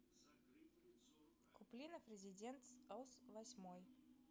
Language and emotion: Russian, neutral